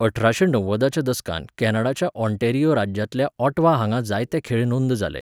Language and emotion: Goan Konkani, neutral